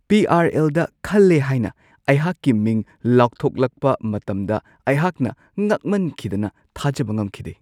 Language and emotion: Manipuri, surprised